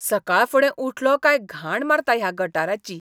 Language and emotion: Goan Konkani, disgusted